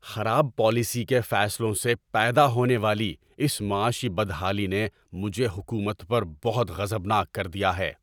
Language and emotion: Urdu, angry